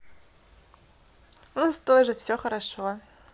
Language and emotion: Russian, positive